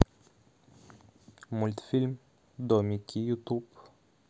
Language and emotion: Russian, neutral